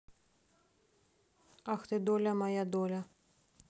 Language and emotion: Russian, neutral